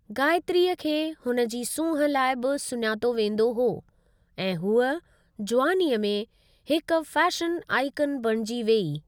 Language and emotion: Sindhi, neutral